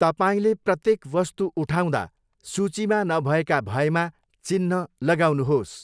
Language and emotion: Nepali, neutral